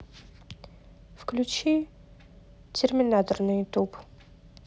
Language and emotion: Russian, neutral